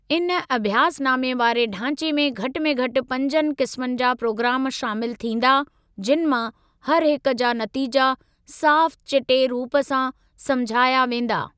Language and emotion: Sindhi, neutral